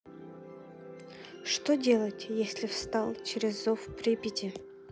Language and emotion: Russian, neutral